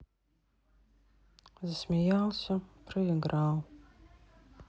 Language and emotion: Russian, sad